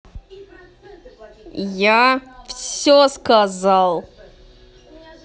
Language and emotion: Russian, angry